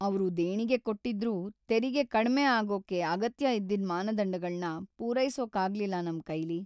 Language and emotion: Kannada, sad